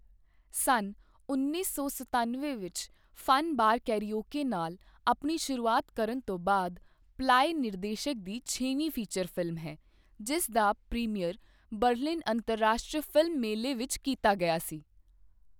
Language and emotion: Punjabi, neutral